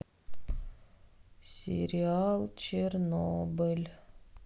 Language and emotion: Russian, sad